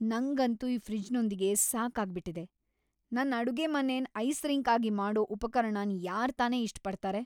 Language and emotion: Kannada, angry